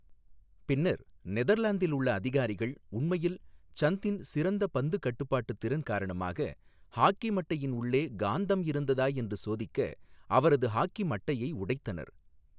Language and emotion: Tamil, neutral